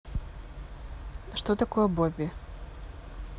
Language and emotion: Russian, neutral